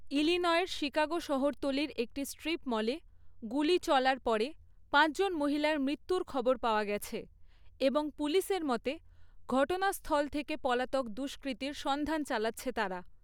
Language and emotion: Bengali, neutral